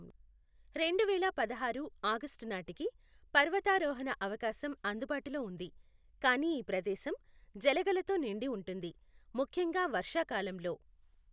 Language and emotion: Telugu, neutral